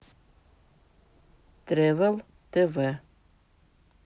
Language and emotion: Russian, neutral